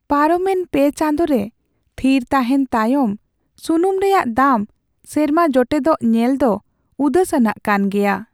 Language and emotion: Santali, sad